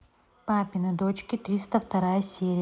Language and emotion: Russian, neutral